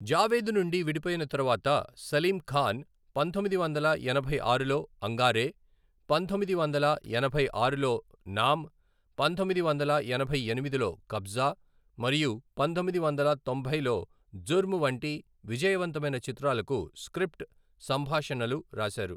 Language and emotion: Telugu, neutral